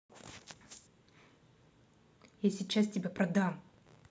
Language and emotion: Russian, angry